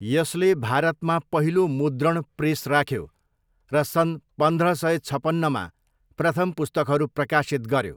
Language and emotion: Nepali, neutral